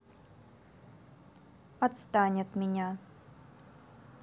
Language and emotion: Russian, angry